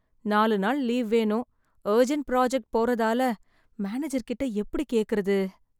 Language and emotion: Tamil, sad